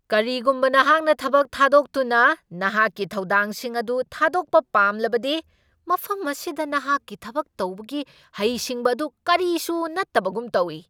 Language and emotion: Manipuri, angry